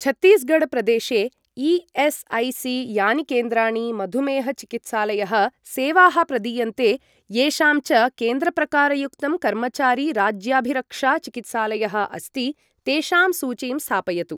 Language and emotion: Sanskrit, neutral